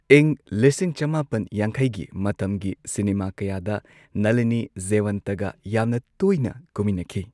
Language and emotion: Manipuri, neutral